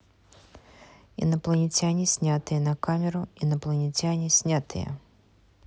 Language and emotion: Russian, neutral